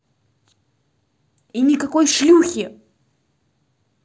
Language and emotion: Russian, angry